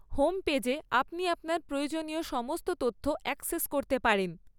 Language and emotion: Bengali, neutral